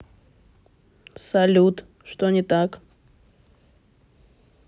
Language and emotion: Russian, neutral